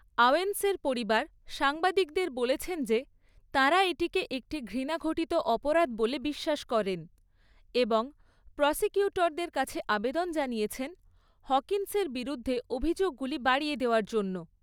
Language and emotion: Bengali, neutral